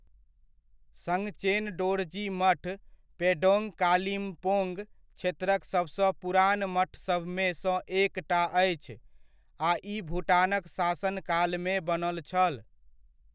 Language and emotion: Maithili, neutral